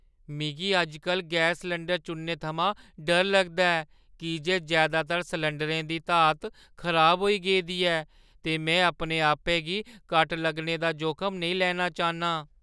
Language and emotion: Dogri, fearful